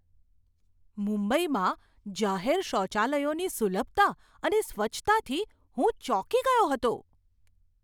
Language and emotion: Gujarati, surprised